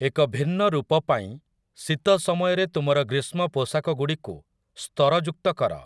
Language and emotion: Odia, neutral